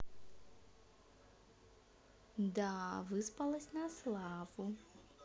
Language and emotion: Russian, positive